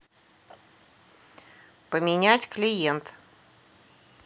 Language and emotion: Russian, neutral